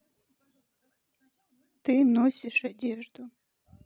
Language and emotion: Russian, sad